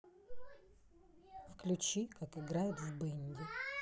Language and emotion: Russian, neutral